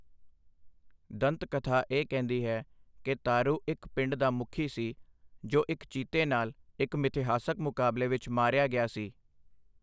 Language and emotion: Punjabi, neutral